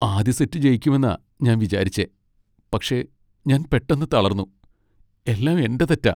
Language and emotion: Malayalam, sad